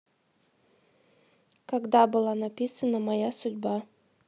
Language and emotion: Russian, neutral